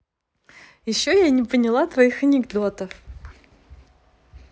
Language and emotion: Russian, positive